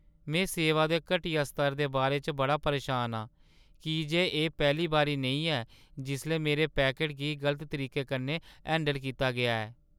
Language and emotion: Dogri, sad